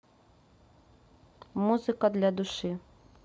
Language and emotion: Russian, neutral